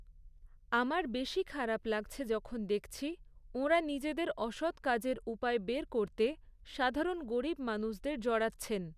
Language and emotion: Bengali, neutral